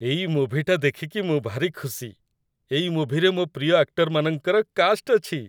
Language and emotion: Odia, happy